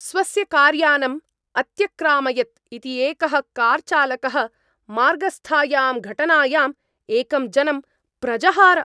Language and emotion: Sanskrit, angry